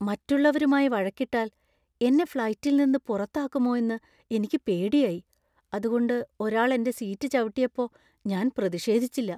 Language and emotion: Malayalam, fearful